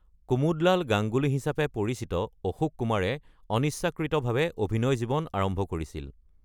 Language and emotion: Assamese, neutral